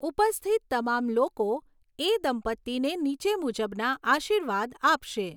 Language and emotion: Gujarati, neutral